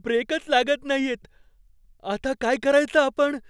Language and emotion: Marathi, fearful